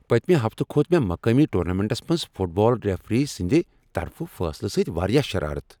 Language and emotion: Kashmiri, angry